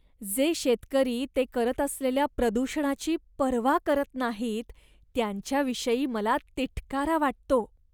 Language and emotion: Marathi, disgusted